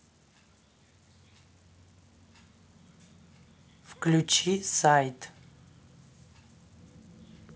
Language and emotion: Russian, neutral